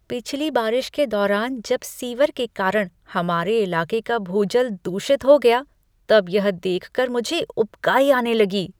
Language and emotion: Hindi, disgusted